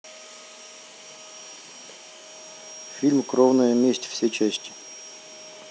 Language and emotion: Russian, neutral